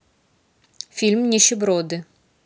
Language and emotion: Russian, neutral